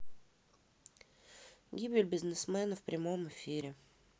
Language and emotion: Russian, neutral